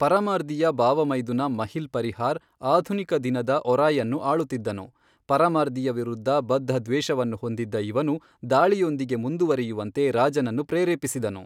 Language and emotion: Kannada, neutral